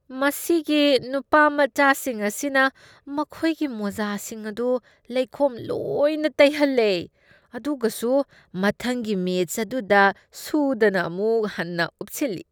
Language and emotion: Manipuri, disgusted